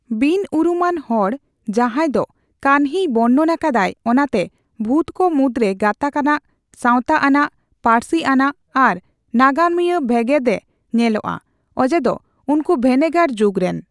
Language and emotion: Santali, neutral